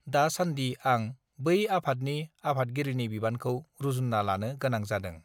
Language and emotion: Bodo, neutral